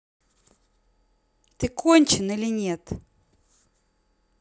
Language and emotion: Russian, angry